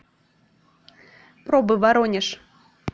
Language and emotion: Russian, neutral